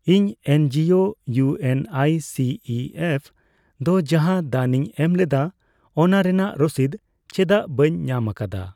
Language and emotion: Santali, neutral